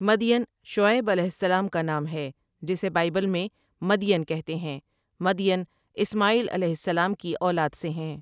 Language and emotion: Urdu, neutral